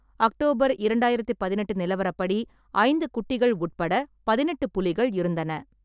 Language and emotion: Tamil, neutral